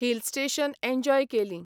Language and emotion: Goan Konkani, neutral